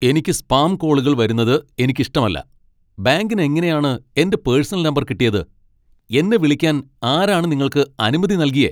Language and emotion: Malayalam, angry